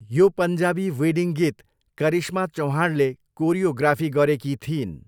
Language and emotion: Nepali, neutral